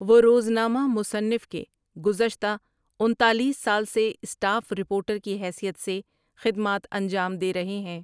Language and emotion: Urdu, neutral